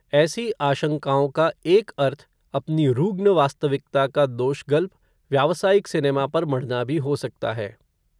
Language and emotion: Hindi, neutral